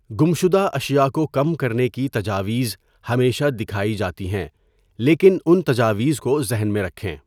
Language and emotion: Urdu, neutral